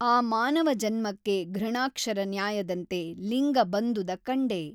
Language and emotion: Kannada, neutral